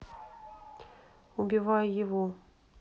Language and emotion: Russian, neutral